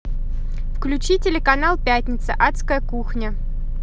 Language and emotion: Russian, neutral